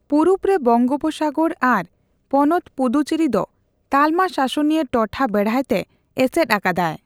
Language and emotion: Santali, neutral